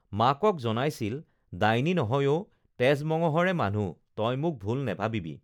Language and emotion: Assamese, neutral